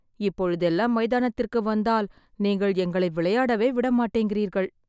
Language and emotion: Tamil, sad